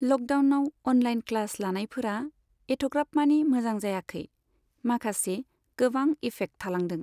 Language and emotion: Bodo, neutral